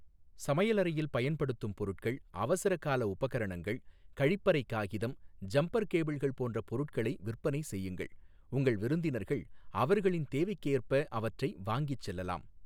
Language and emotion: Tamil, neutral